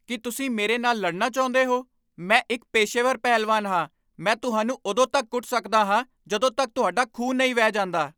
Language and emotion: Punjabi, angry